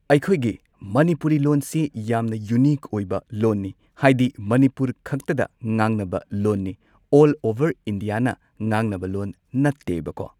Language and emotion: Manipuri, neutral